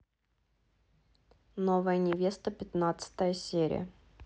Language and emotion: Russian, neutral